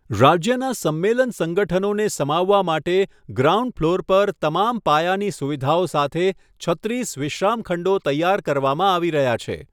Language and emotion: Gujarati, neutral